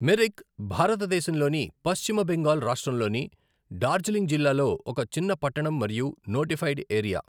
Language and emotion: Telugu, neutral